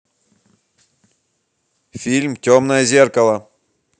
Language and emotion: Russian, angry